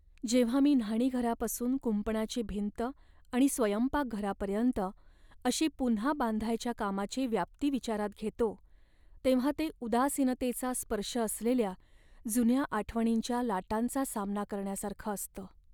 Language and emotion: Marathi, sad